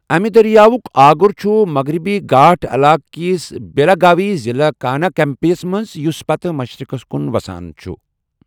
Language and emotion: Kashmiri, neutral